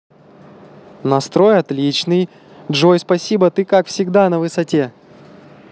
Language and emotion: Russian, positive